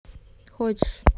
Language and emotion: Russian, neutral